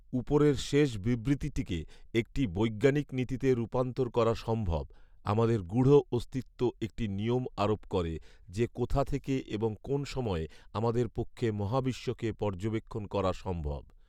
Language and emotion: Bengali, neutral